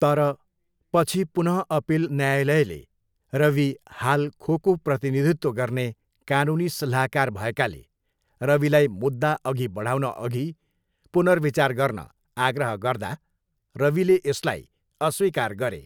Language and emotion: Nepali, neutral